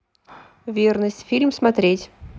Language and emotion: Russian, neutral